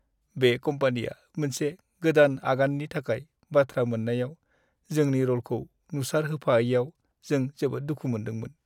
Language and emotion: Bodo, sad